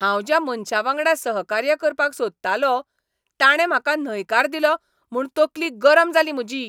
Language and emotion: Goan Konkani, angry